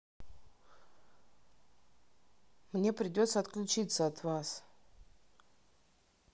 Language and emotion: Russian, neutral